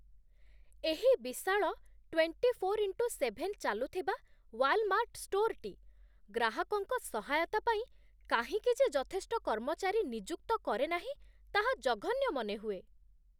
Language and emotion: Odia, disgusted